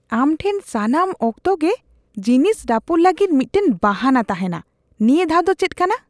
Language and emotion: Santali, disgusted